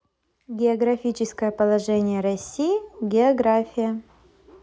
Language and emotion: Russian, positive